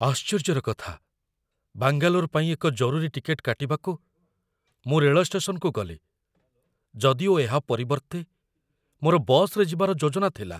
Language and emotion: Odia, fearful